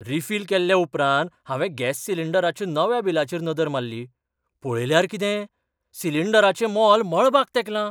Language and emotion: Goan Konkani, surprised